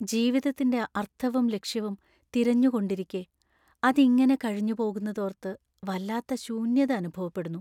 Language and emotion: Malayalam, sad